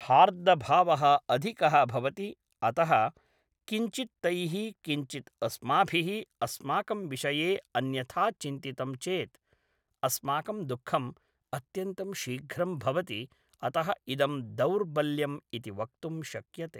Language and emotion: Sanskrit, neutral